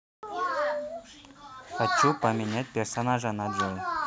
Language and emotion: Russian, neutral